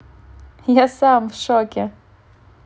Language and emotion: Russian, positive